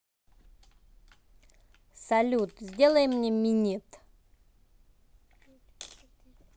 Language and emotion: Russian, neutral